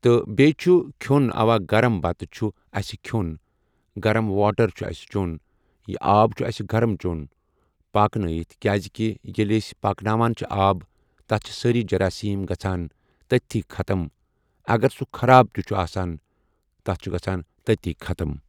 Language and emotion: Kashmiri, neutral